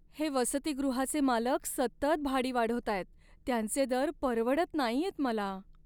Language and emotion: Marathi, sad